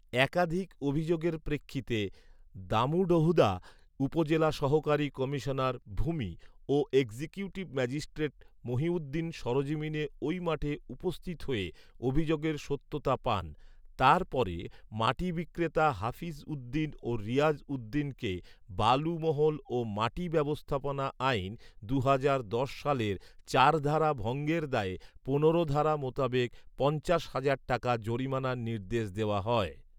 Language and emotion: Bengali, neutral